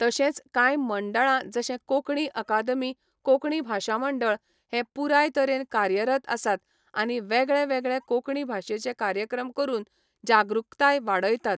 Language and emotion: Goan Konkani, neutral